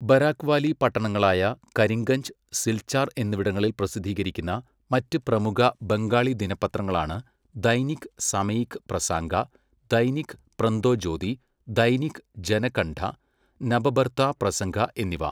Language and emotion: Malayalam, neutral